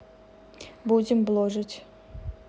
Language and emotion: Russian, neutral